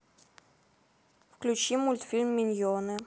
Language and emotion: Russian, neutral